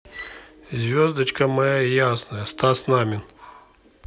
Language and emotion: Russian, neutral